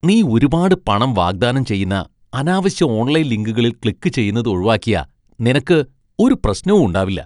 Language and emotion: Malayalam, disgusted